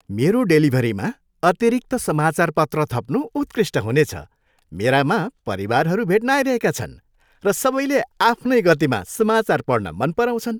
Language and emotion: Nepali, happy